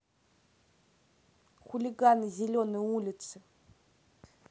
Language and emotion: Russian, angry